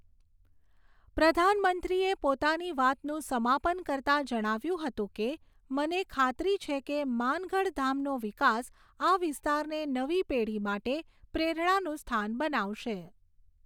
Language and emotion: Gujarati, neutral